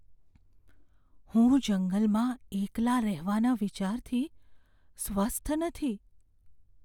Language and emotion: Gujarati, fearful